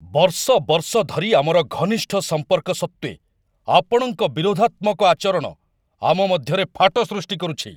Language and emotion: Odia, angry